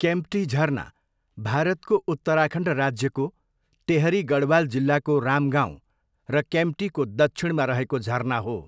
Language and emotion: Nepali, neutral